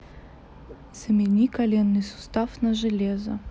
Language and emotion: Russian, neutral